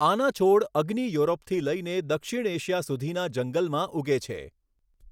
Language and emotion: Gujarati, neutral